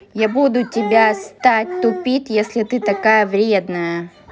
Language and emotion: Russian, angry